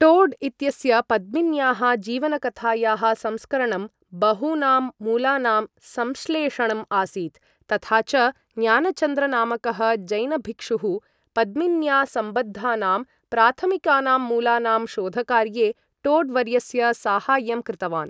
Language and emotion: Sanskrit, neutral